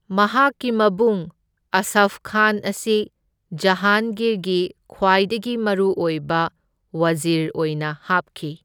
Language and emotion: Manipuri, neutral